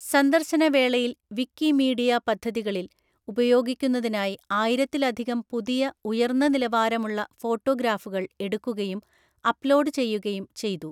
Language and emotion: Malayalam, neutral